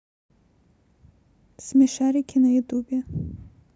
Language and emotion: Russian, neutral